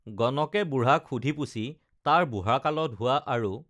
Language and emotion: Assamese, neutral